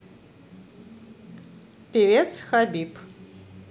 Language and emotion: Russian, neutral